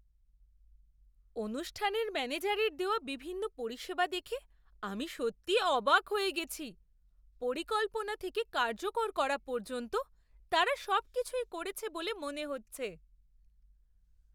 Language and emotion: Bengali, surprised